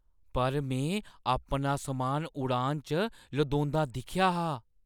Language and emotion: Dogri, surprised